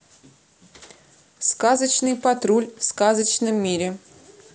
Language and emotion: Russian, neutral